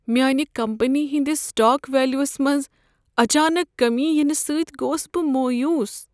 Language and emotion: Kashmiri, sad